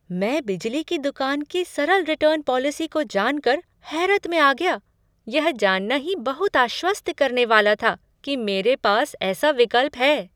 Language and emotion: Hindi, surprised